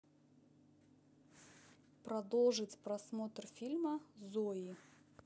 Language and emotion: Russian, neutral